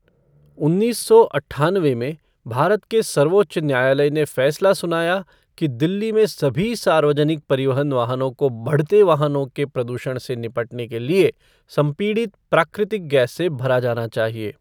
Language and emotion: Hindi, neutral